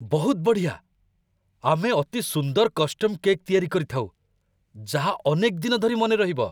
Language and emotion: Odia, surprised